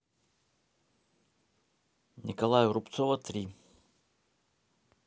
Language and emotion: Russian, neutral